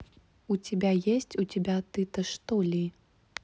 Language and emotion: Russian, neutral